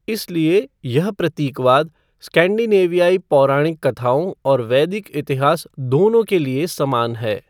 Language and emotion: Hindi, neutral